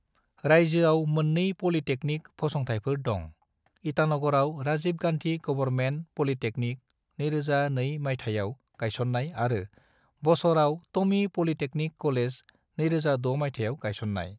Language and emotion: Bodo, neutral